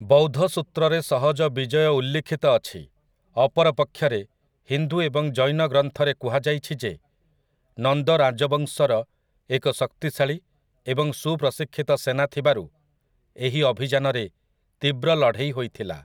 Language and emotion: Odia, neutral